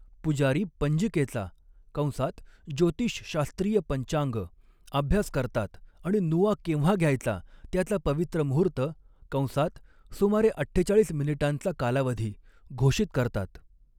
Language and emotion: Marathi, neutral